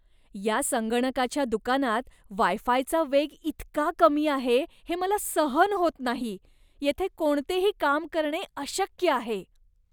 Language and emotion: Marathi, disgusted